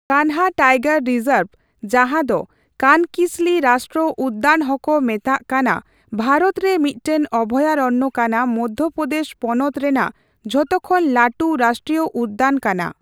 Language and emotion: Santali, neutral